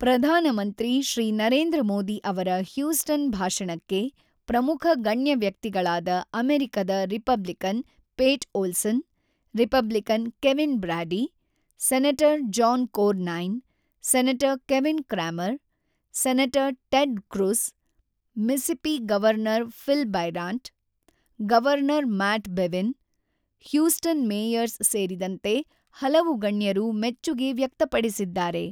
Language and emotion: Kannada, neutral